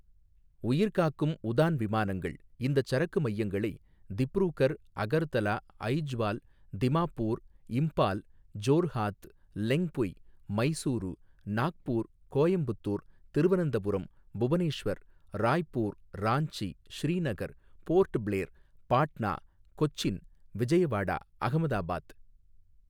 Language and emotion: Tamil, neutral